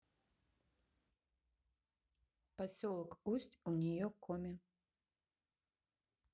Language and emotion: Russian, neutral